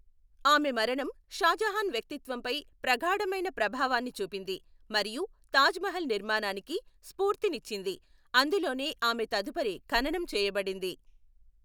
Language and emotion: Telugu, neutral